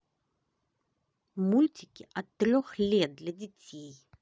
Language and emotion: Russian, positive